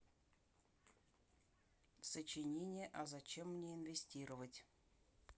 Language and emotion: Russian, neutral